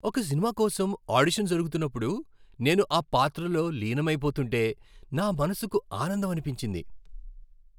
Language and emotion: Telugu, happy